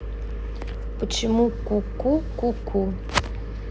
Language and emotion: Russian, neutral